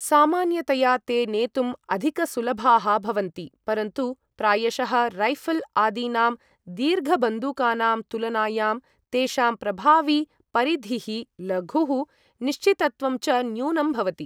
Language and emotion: Sanskrit, neutral